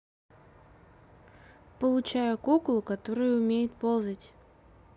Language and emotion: Russian, neutral